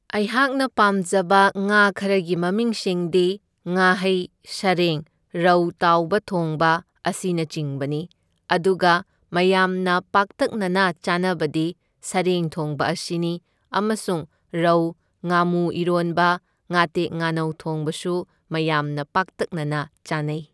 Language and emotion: Manipuri, neutral